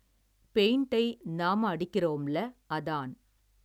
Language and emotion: Tamil, neutral